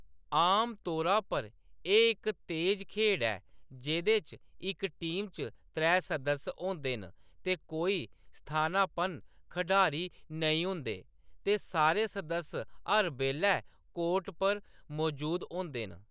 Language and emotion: Dogri, neutral